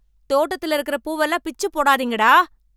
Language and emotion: Tamil, angry